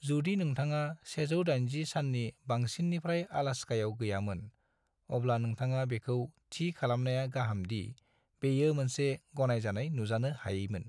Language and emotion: Bodo, neutral